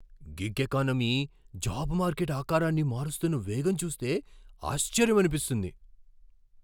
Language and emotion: Telugu, surprised